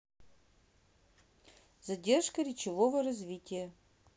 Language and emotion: Russian, neutral